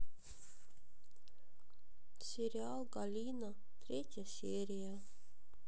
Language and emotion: Russian, sad